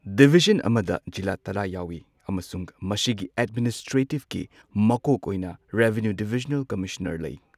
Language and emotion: Manipuri, neutral